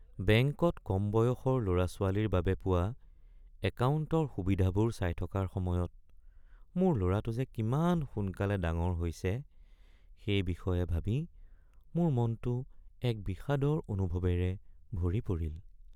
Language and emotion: Assamese, sad